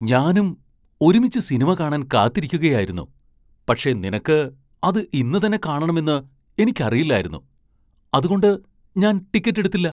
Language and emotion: Malayalam, surprised